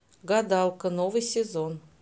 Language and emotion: Russian, neutral